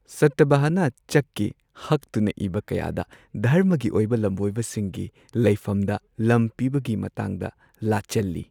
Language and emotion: Manipuri, neutral